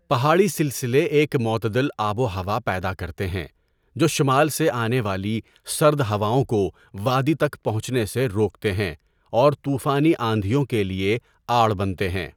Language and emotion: Urdu, neutral